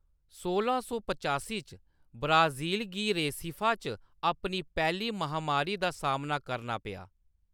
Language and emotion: Dogri, neutral